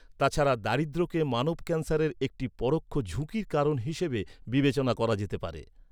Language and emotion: Bengali, neutral